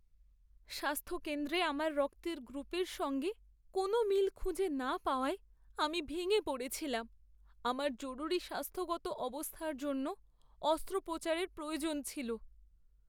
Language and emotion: Bengali, sad